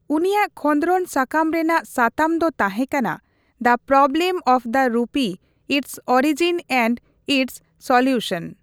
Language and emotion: Santali, neutral